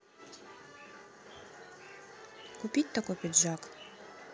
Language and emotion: Russian, neutral